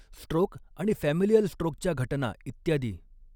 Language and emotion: Marathi, neutral